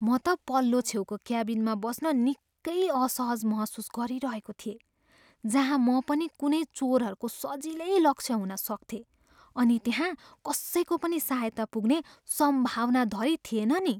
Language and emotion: Nepali, fearful